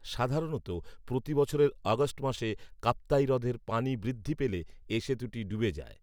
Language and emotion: Bengali, neutral